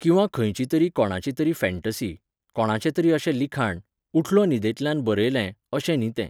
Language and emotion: Goan Konkani, neutral